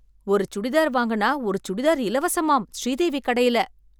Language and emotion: Tamil, surprised